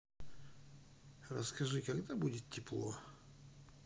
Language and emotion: Russian, neutral